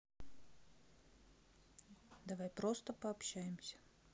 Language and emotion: Russian, neutral